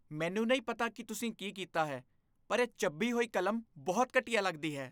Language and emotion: Punjabi, disgusted